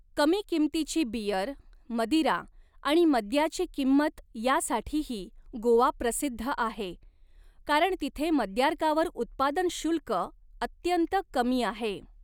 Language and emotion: Marathi, neutral